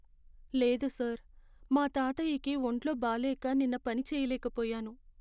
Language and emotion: Telugu, sad